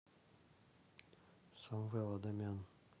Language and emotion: Russian, neutral